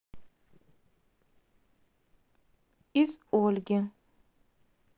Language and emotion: Russian, neutral